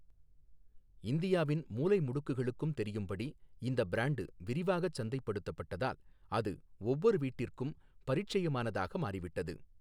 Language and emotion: Tamil, neutral